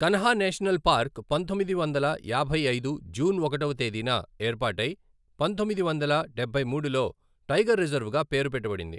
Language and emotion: Telugu, neutral